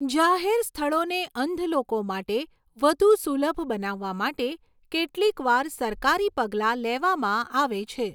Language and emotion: Gujarati, neutral